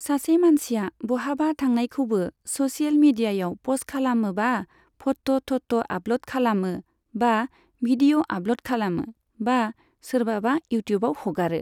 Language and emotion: Bodo, neutral